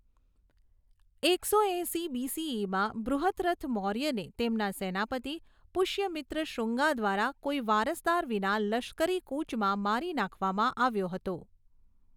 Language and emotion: Gujarati, neutral